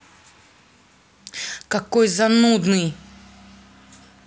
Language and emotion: Russian, angry